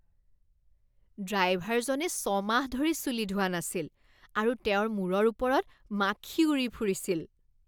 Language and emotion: Assamese, disgusted